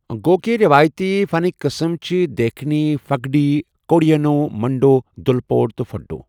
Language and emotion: Kashmiri, neutral